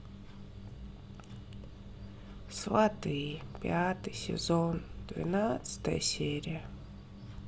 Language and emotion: Russian, sad